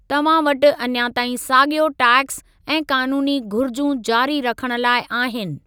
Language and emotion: Sindhi, neutral